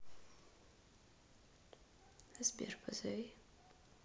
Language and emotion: Russian, neutral